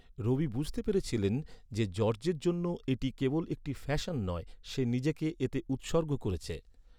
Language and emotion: Bengali, neutral